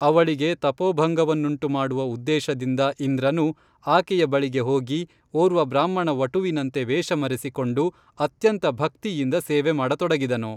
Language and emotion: Kannada, neutral